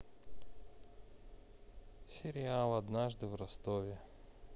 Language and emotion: Russian, neutral